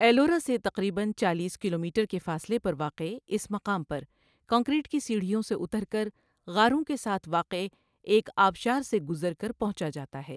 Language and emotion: Urdu, neutral